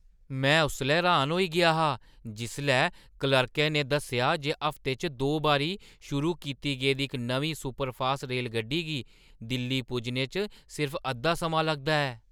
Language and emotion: Dogri, surprised